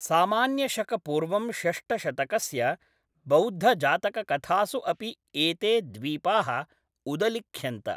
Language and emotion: Sanskrit, neutral